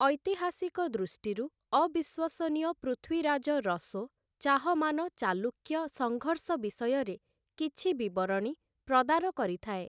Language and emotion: Odia, neutral